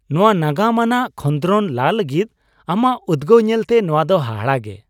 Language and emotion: Santali, happy